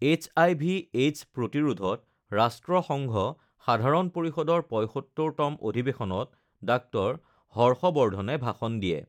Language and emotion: Assamese, neutral